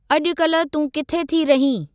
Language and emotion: Sindhi, neutral